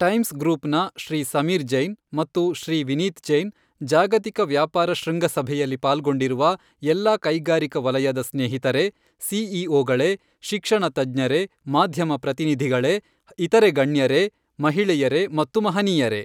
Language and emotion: Kannada, neutral